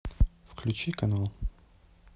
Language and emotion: Russian, neutral